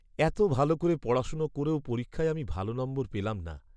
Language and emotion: Bengali, sad